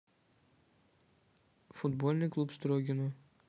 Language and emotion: Russian, neutral